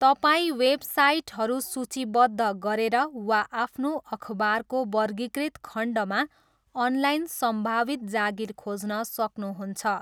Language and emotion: Nepali, neutral